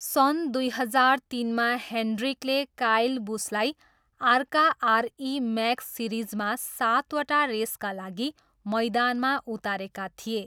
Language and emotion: Nepali, neutral